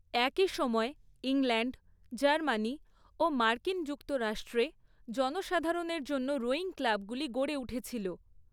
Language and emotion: Bengali, neutral